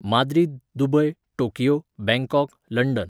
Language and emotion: Goan Konkani, neutral